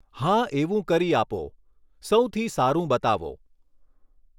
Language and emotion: Gujarati, neutral